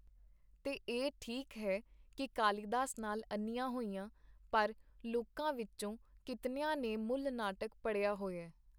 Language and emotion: Punjabi, neutral